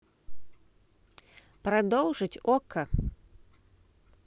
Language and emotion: Russian, neutral